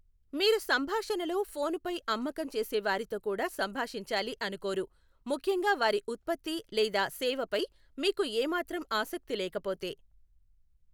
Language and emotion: Telugu, neutral